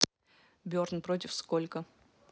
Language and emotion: Russian, neutral